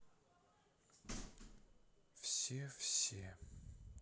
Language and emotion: Russian, sad